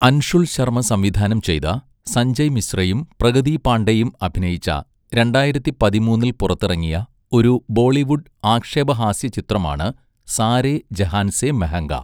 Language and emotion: Malayalam, neutral